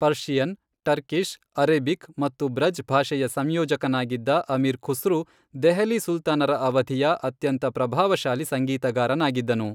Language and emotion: Kannada, neutral